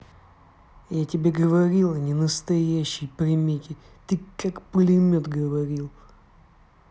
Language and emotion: Russian, angry